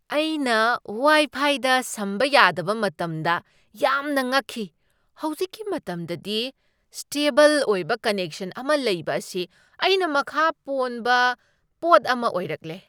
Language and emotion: Manipuri, surprised